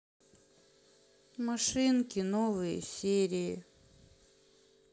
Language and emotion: Russian, sad